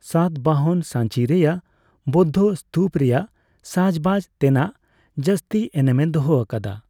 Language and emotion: Santali, neutral